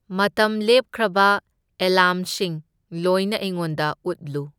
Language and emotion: Manipuri, neutral